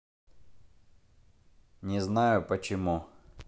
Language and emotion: Russian, neutral